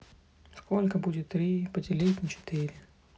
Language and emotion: Russian, sad